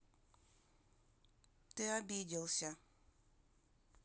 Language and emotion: Russian, sad